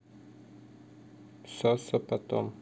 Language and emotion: Russian, neutral